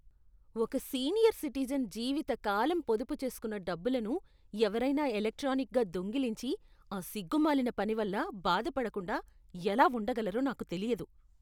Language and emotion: Telugu, disgusted